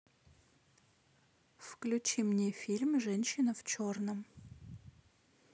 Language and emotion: Russian, neutral